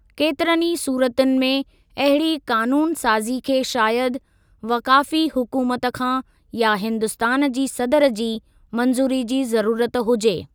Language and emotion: Sindhi, neutral